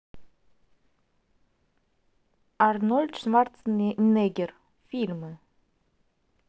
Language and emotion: Russian, neutral